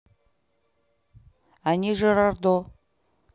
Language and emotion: Russian, neutral